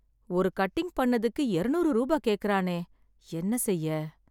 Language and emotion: Tamil, sad